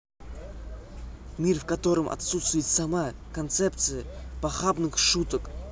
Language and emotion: Russian, neutral